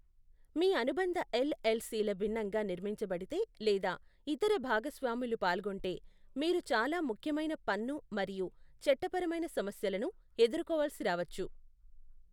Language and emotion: Telugu, neutral